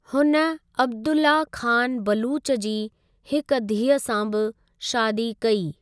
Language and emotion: Sindhi, neutral